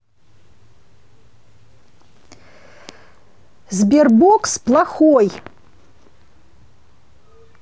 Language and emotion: Russian, angry